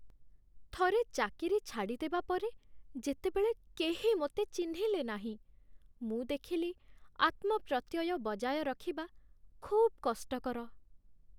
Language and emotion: Odia, sad